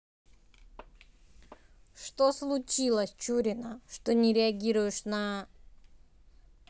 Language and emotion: Russian, neutral